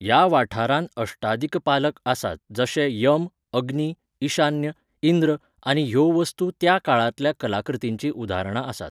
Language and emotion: Goan Konkani, neutral